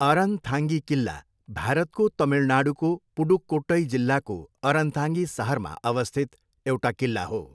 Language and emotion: Nepali, neutral